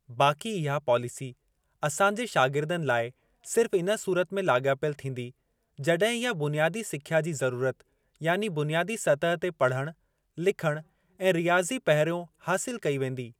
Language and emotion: Sindhi, neutral